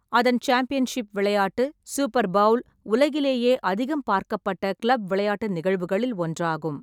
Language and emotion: Tamil, neutral